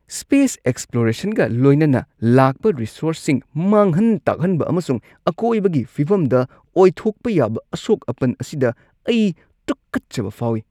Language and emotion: Manipuri, disgusted